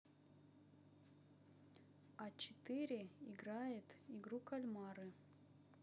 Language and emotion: Russian, neutral